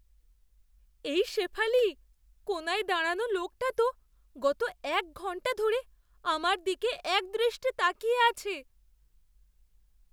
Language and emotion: Bengali, fearful